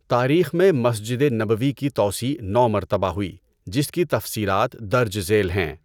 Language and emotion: Urdu, neutral